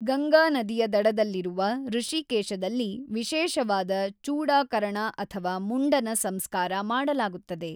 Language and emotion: Kannada, neutral